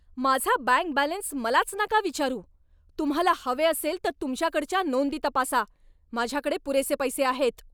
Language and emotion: Marathi, angry